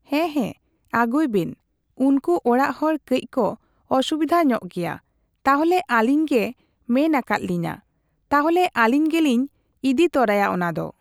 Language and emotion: Santali, neutral